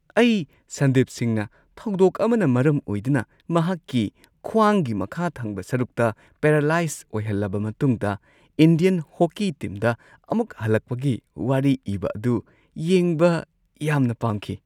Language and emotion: Manipuri, happy